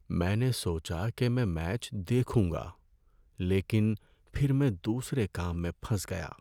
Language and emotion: Urdu, sad